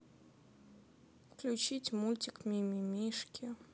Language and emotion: Russian, sad